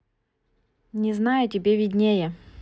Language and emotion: Russian, neutral